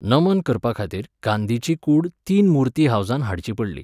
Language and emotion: Goan Konkani, neutral